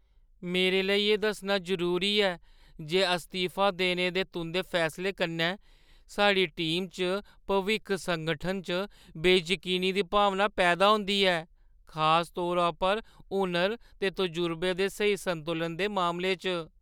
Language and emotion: Dogri, fearful